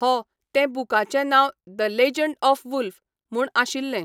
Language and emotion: Goan Konkani, neutral